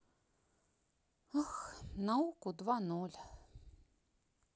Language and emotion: Russian, sad